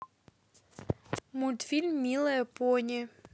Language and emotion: Russian, neutral